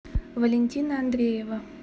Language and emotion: Russian, neutral